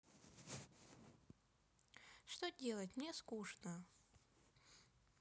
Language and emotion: Russian, sad